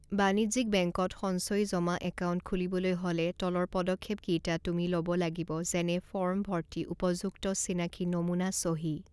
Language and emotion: Assamese, neutral